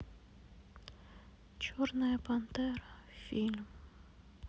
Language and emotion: Russian, sad